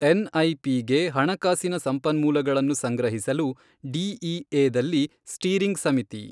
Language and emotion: Kannada, neutral